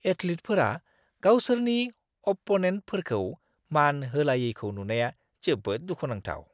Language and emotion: Bodo, disgusted